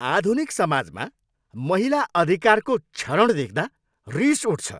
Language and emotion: Nepali, angry